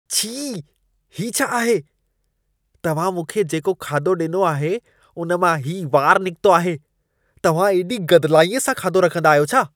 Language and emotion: Sindhi, disgusted